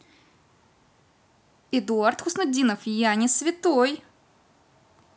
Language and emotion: Russian, neutral